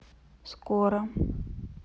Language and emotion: Russian, neutral